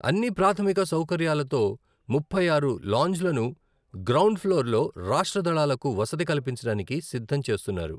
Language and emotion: Telugu, neutral